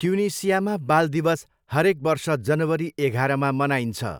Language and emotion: Nepali, neutral